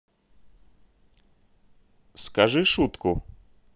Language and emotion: Russian, neutral